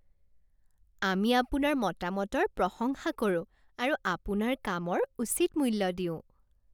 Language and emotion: Assamese, happy